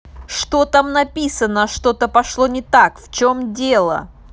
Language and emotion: Russian, angry